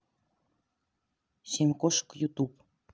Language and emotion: Russian, neutral